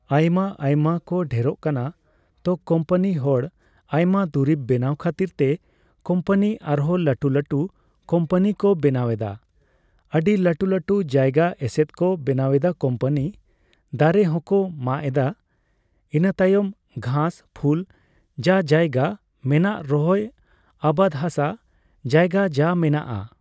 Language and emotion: Santali, neutral